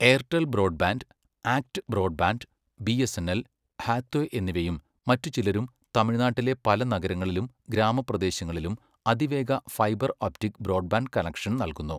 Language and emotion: Malayalam, neutral